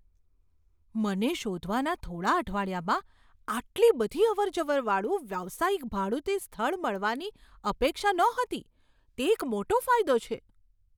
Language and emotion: Gujarati, surprised